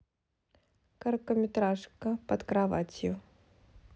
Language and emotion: Russian, neutral